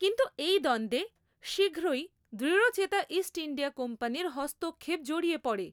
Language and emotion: Bengali, neutral